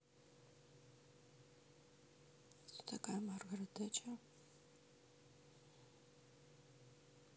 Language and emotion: Russian, sad